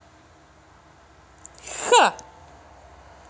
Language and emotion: Russian, positive